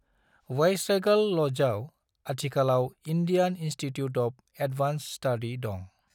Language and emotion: Bodo, neutral